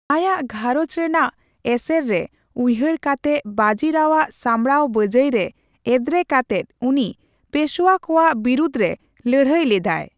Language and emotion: Santali, neutral